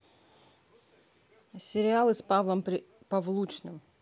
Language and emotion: Russian, neutral